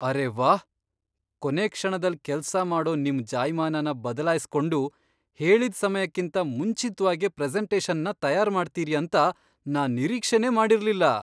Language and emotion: Kannada, surprised